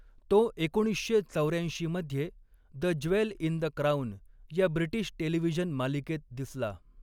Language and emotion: Marathi, neutral